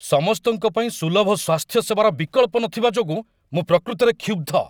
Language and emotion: Odia, angry